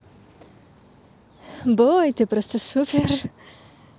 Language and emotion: Russian, positive